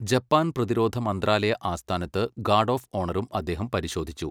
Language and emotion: Malayalam, neutral